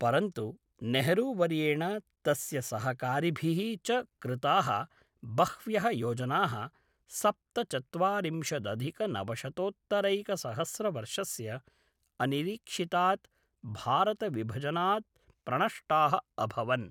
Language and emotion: Sanskrit, neutral